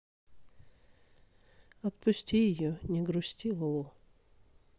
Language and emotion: Russian, sad